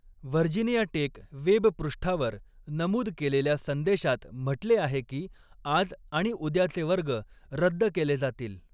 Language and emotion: Marathi, neutral